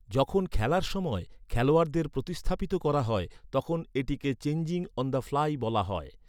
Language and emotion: Bengali, neutral